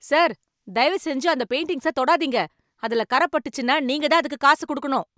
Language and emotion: Tamil, angry